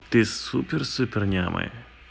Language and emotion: Russian, positive